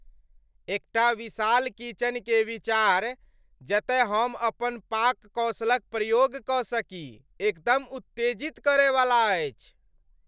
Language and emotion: Maithili, happy